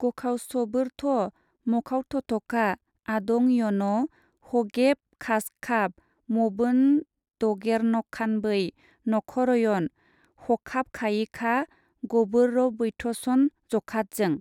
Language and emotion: Bodo, neutral